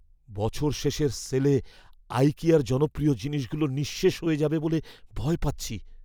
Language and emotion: Bengali, fearful